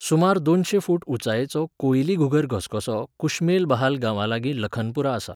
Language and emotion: Goan Konkani, neutral